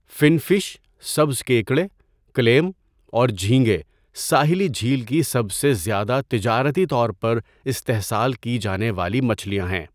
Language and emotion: Urdu, neutral